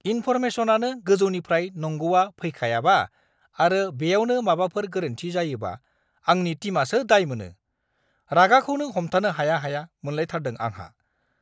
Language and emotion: Bodo, angry